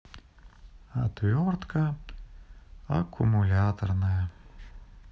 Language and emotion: Russian, sad